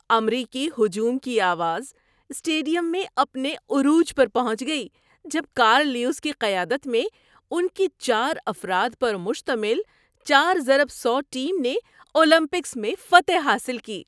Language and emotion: Urdu, happy